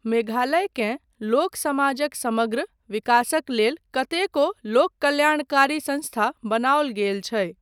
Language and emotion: Maithili, neutral